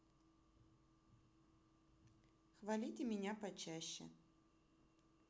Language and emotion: Russian, neutral